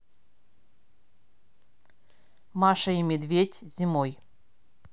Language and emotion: Russian, neutral